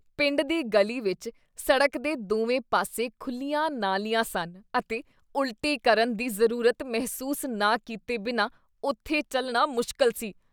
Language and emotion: Punjabi, disgusted